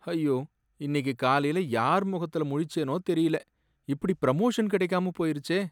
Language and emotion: Tamil, sad